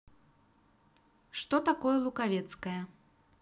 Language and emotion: Russian, neutral